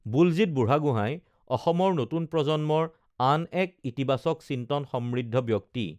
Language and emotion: Assamese, neutral